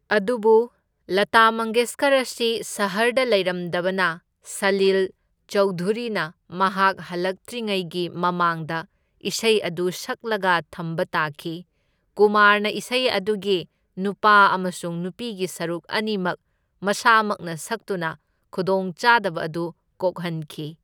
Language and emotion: Manipuri, neutral